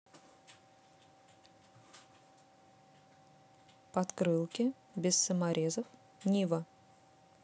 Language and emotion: Russian, neutral